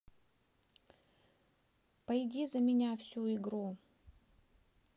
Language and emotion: Russian, neutral